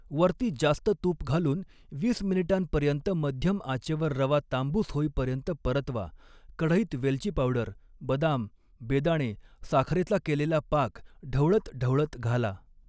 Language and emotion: Marathi, neutral